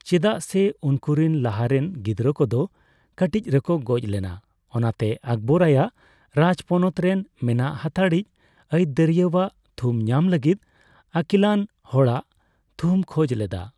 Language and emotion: Santali, neutral